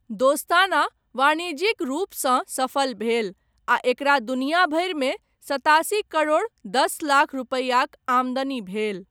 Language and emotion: Maithili, neutral